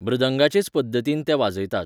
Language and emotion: Goan Konkani, neutral